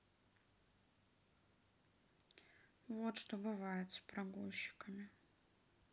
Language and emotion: Russian, sad